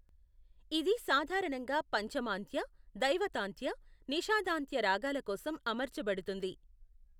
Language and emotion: Telugu, neutral